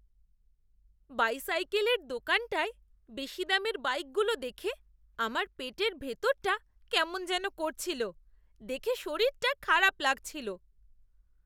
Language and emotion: Bengali, disgusted